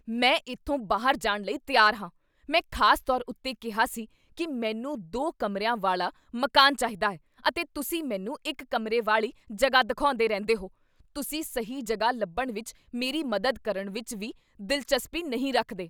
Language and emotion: Punjabi, angry